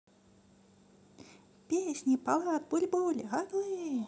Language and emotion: Russian, positive